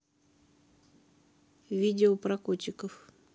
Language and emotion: Russian, neutral